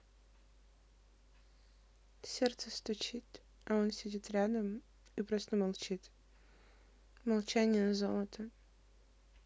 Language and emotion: Russian, sad